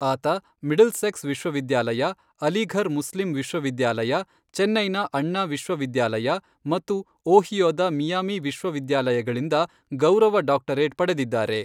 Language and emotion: Kannada, neutral